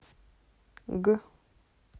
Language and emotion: Russian, neutral